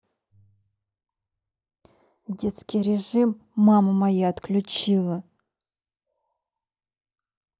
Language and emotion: Russian, angry